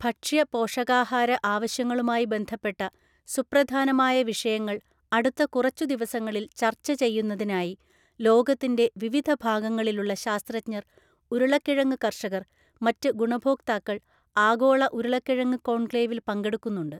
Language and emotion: Malayalam, neutral